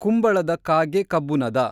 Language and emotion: Kannada, neutral